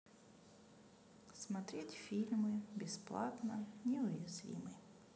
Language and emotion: Russian, neutral